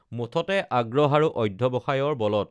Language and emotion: Assamese, neutral